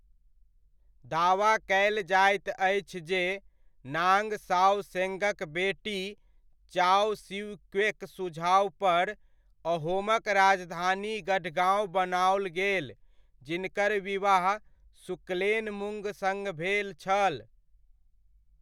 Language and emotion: Maithili, neutral